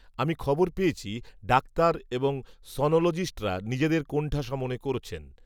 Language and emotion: Bengali, neutral